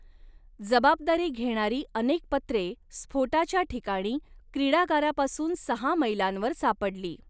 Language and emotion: Marathi, neutral